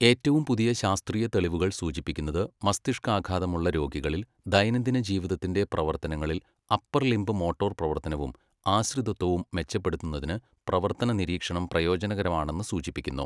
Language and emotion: Malayalam, neutral